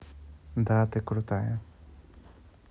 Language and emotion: Russian, neutral